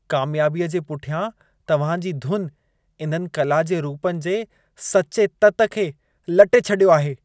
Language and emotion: Sindhi, disgusted